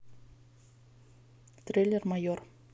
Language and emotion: Russian, neutral